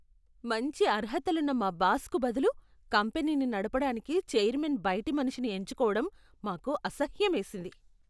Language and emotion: Telugu, disgusted